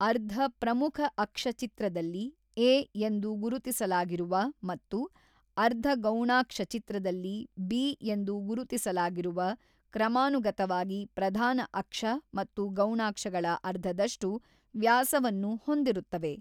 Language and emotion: Kannada, neutral